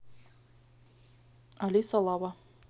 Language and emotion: Russian, neutral